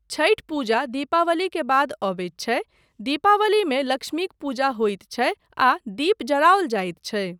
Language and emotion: Maithili, neutral